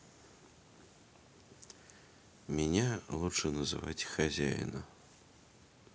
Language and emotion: Russian, neutral